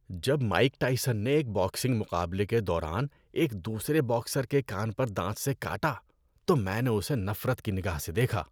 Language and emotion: Urdu, disgusted